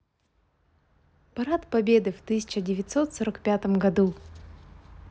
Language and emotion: Russian, positive